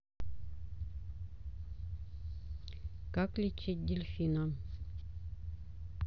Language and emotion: Russian, neutral